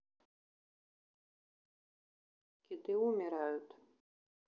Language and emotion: Russian, neutral